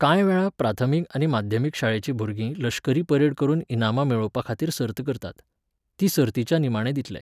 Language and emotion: Goan Konkani, neutral